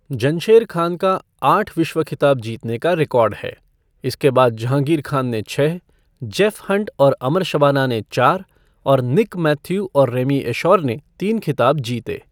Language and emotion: Hindi, neutral